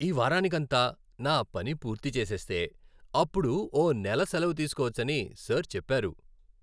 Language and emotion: Telugu, happy